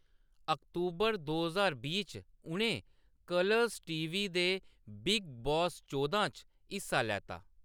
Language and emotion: Dogri, neutral